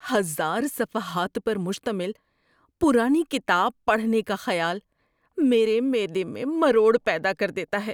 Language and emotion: Urdu, disgusted